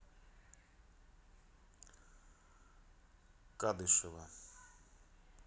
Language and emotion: Russian, neutral